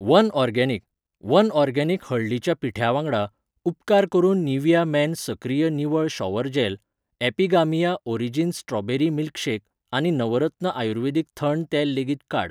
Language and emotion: Goan Konkani, neutral